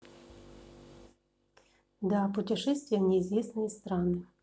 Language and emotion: Russian, neutral